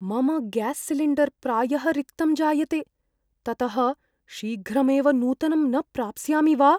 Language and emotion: Sanskrit, fearful